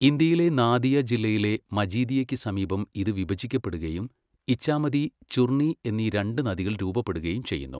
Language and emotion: Malayalam, neutral